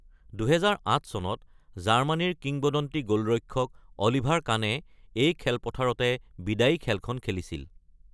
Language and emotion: Assamese, neutral